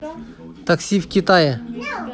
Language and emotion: Russian, neutral